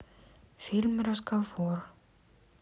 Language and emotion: Russian, neutral